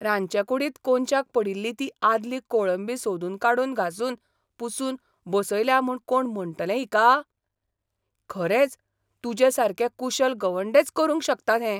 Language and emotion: Goan Konkani, surprised